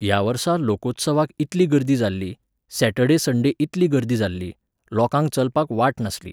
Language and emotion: Goan Konkani, neutral